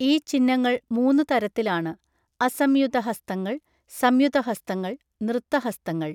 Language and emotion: Malayalam, neutral